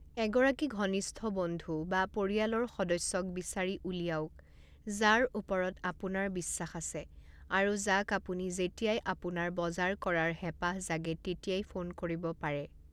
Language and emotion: Assamese, neutral